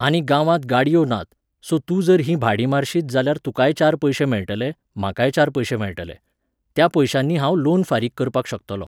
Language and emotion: Goan Konkani, neutral